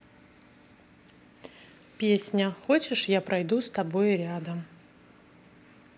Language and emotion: Russian, neutral